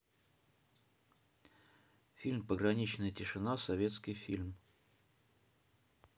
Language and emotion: Russian, neutral